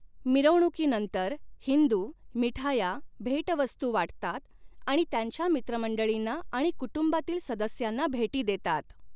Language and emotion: Marathi, neutral